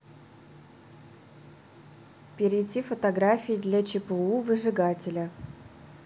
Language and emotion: Russian, neutral